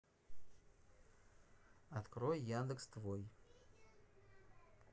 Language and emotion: Russian, neutral